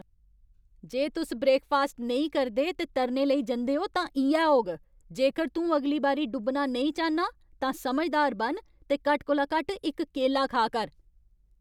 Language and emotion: Dogri, angry